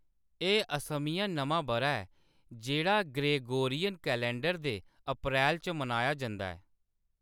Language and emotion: Dogri, neutral